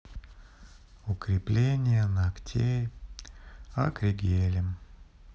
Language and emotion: Russian, sad